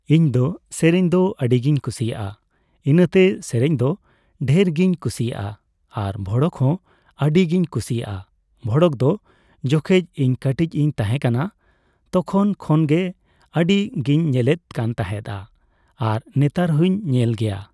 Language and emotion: Santali, neutral